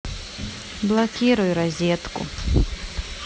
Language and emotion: Russian, neutral